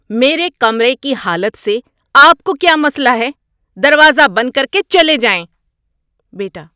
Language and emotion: Urdu, angry